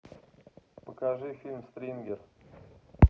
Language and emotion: Russian, neutral